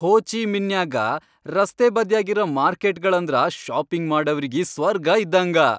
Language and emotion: Kannada, happy